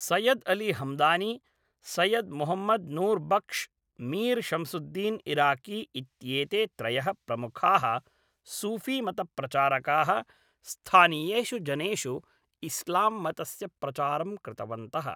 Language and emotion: Sanskrit, neutral